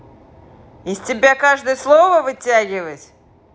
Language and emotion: Russian, angry